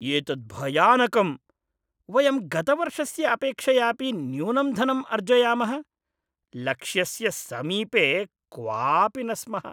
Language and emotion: Sanskrit, disgusted